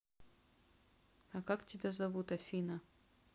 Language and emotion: Russian, neutral